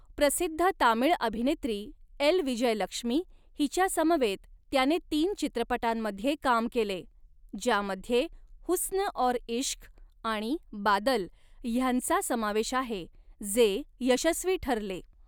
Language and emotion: Marathi, neutral